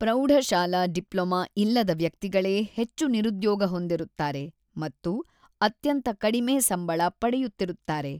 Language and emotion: Kannada, neutral